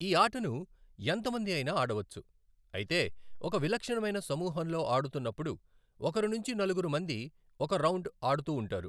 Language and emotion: Telugu, neutral